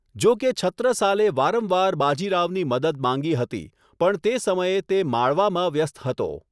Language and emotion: Gujarati, neutral